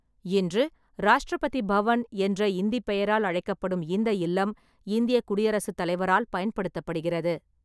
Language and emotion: Tamil, neutral